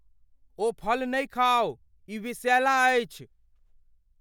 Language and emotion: Maithili, fearful